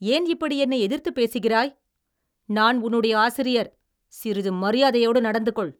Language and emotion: Tamil, angry